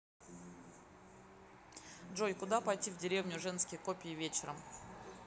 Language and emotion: Russian, neutral